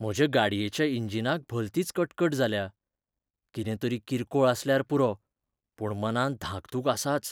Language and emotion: Goan Konkani, fearful